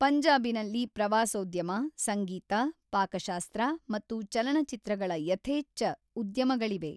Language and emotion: Kannada, neutral